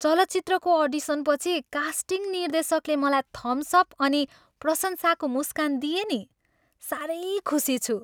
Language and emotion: Nepali, happy